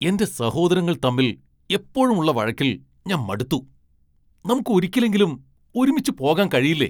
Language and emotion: Malayalam, angry